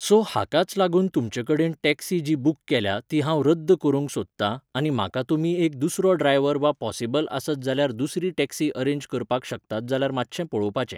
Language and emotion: Goan Konkani, neutral